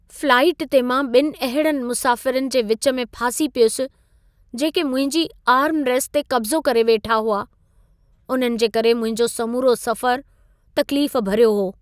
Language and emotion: Sindhi, sad